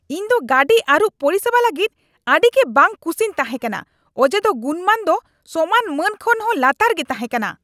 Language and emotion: Santali, angry